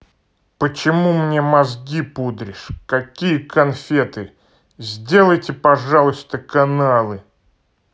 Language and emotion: Russian, angry